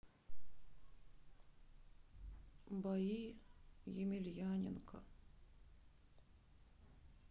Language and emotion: Russian, sad